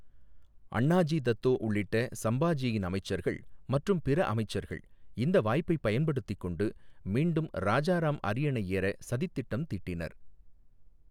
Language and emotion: Tamil, neutral